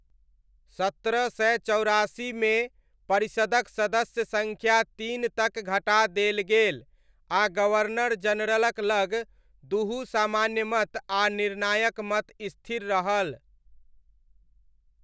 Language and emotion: Maithili, neutral